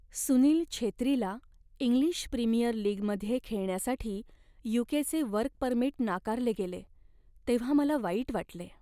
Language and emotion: Marathi, sad